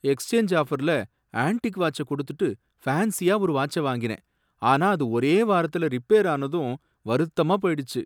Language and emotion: Tamil, sad